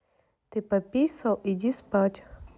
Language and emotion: Russian, neutral